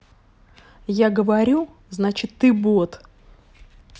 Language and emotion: Russian, angry